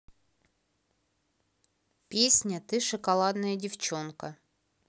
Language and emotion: Russian, neutral